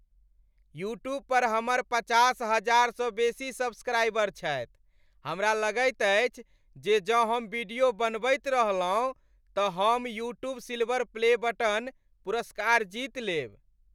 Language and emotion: Maithili, happy